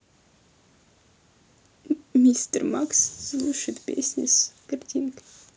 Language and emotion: Russian, sad